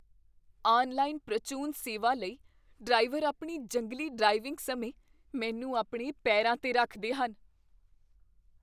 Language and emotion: Punjabi, fearful